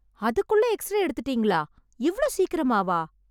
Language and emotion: Tamil, surprised